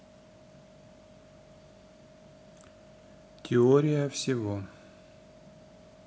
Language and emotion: Russian, neutral